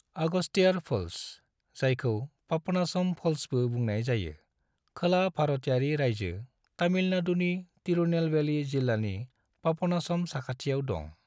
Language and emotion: Bodo, neutral